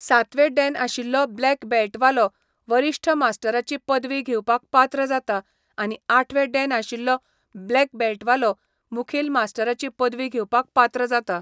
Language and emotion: Goan Konkani, neutral